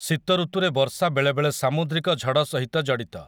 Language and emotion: Odia, neutral